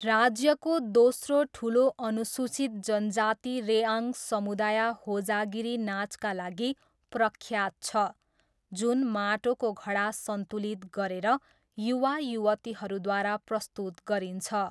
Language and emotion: Nepali, neutral